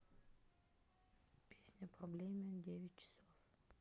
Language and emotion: Russian, neutral